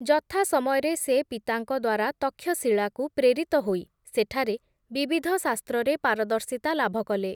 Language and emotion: Odia, neutral